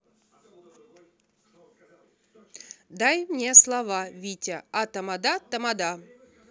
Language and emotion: Russian, neutral